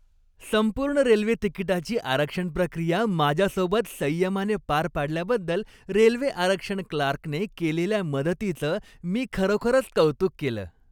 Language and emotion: Marathi, happy